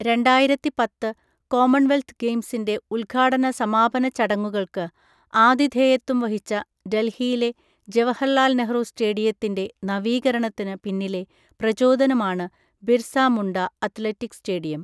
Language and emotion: Malayalam, neutral